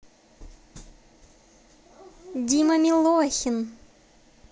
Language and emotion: Russian, positive